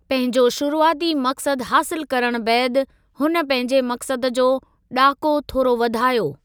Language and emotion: Sindhi, neutral